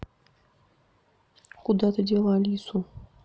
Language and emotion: Russian, neutral